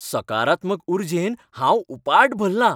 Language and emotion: Goan Konkani, happy